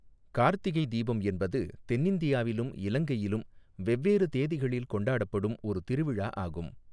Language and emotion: Tamil, neutral